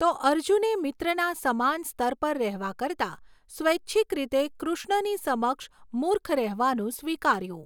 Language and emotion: Gujarati, neutral